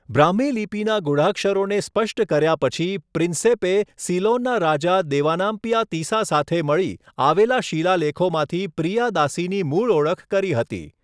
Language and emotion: Gujarati, neutral